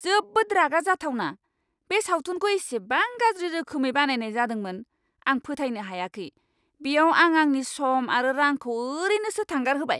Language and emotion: Bodo, angry